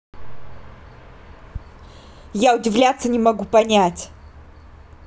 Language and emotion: Russian, angry